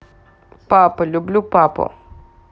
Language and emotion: Russian, neutral